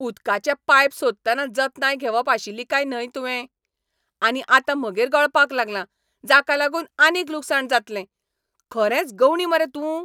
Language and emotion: Goan Konkani, angry